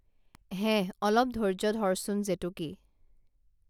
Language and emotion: Assamese, neutral